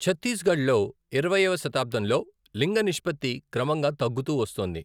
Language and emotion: Telugu, neutral